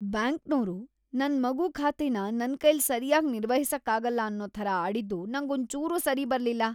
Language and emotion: Kannada, disgusted